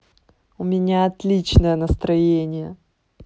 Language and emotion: Russian, positive